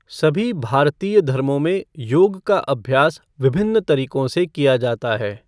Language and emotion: Hindi, neutral